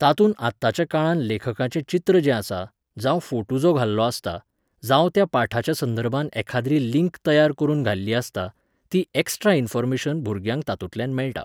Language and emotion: Goan Konkani, neutral